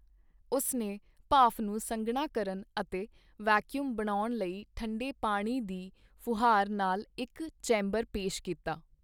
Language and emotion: Punjabi, neutral